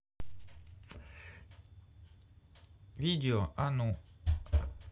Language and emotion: Russian, neutral